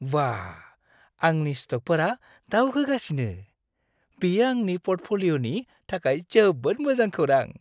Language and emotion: Bodo, happy